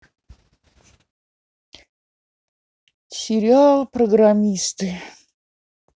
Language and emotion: Russian, neutral